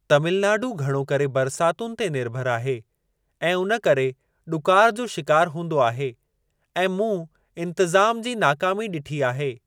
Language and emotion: Sindhi, neutral